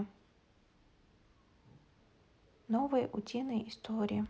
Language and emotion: Russian, neutral